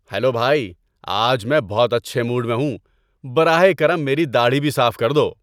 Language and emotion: Urdu, happy